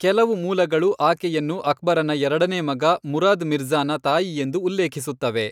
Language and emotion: Kannada, neutral